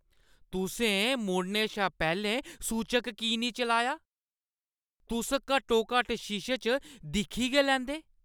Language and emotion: Dogri, angry